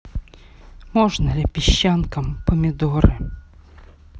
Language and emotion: Russian, neutral